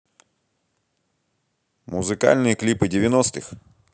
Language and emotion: Russian, positive